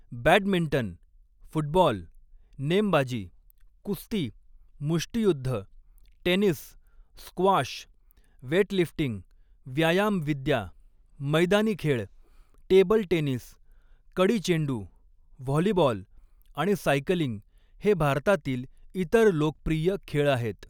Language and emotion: Marathi, neutral